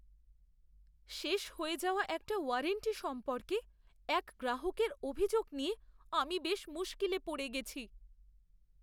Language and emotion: Bengali, fearful